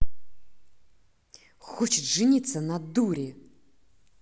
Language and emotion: Russian, angry